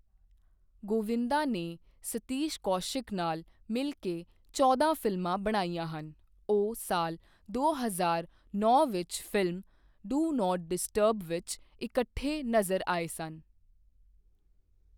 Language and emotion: Punjabi, neutral